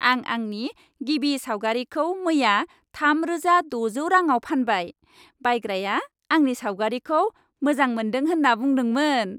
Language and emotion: Bodo, happy